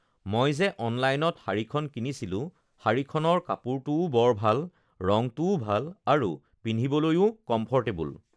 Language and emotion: Assamese, neutral